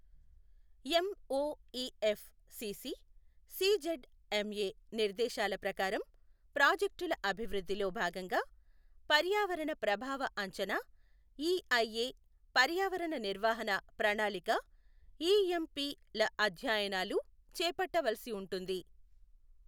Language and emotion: Telugu, neutral